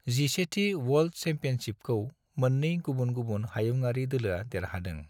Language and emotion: Bodo, neutral